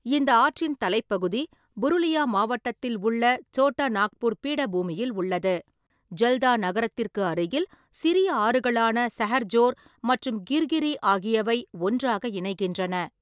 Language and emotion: Tamil, neutral